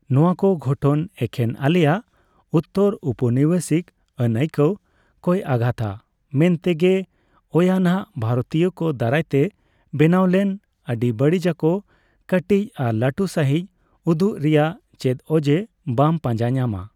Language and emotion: Santali, neutral